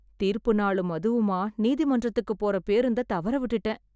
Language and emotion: Tamil, sad